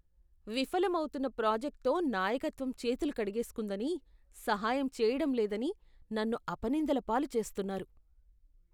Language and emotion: Telugu, disgusted